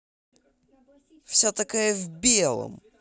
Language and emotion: Russian, angry